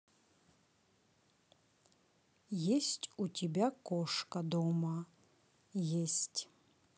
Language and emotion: Russian, neutral